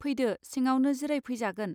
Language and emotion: Bodo, neutral